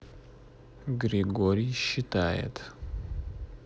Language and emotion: Russian, neutral